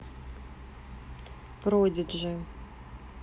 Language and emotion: Russian, neutral